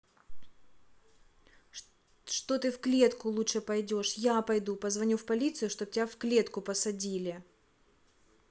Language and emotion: Russian, angry